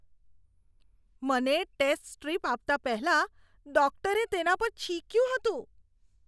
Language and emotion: Gujarati, disgusted